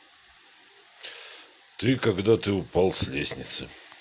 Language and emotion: Russian, neutral